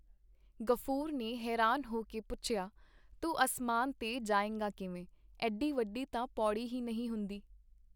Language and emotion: Punjabi, neutral